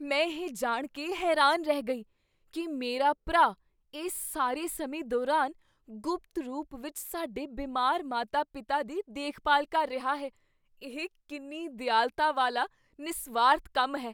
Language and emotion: Punjabi, surprised